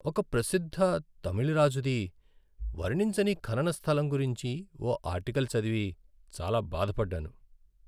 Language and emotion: Telugu, sad